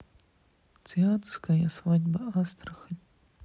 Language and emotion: Russian, sad